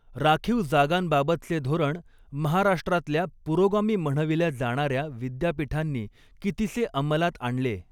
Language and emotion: Marathi, neutral